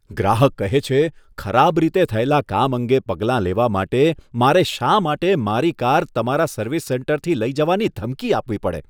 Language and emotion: Gujarati, disgusted